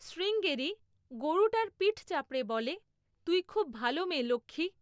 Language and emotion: Bengali, neutral